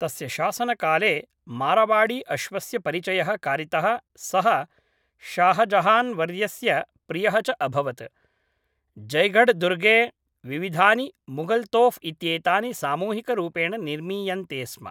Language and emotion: Sanskrit, neutral